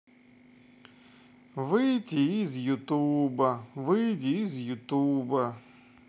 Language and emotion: Russian, neutral